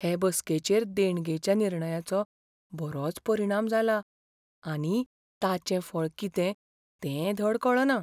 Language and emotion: Goan Konkani, fearful